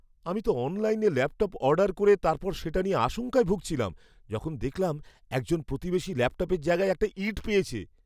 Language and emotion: Bengali, fearful